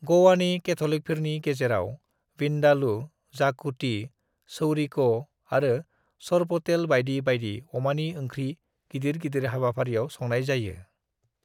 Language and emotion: Bodo, neutral